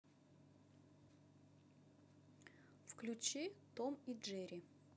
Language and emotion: Russian, neutral